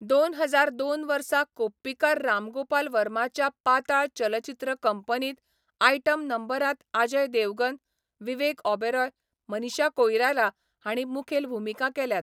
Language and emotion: Goan Konkani, neutral